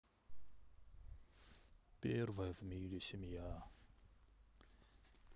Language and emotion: Russian, sad